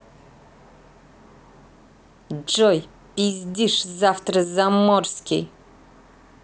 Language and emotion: Russian, angry